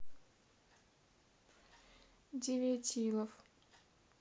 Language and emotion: Russian, neutral